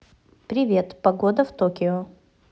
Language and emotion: Russian, positive